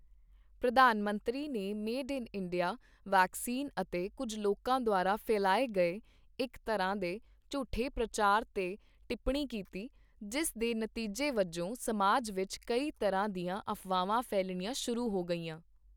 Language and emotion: Punjabi, neutral